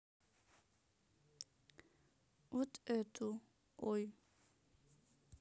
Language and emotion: Russian, neutral